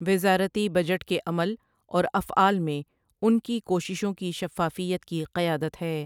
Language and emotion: Urdu, neutral